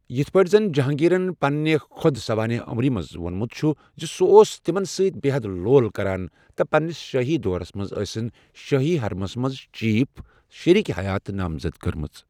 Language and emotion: Kashmiri, neutral